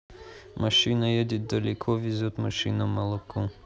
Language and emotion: Russian, neutral